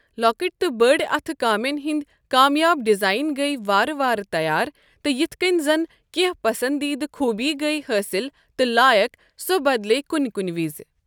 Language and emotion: Kashmiri, neutral